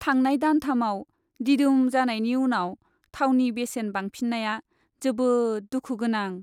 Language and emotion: Bodo, sad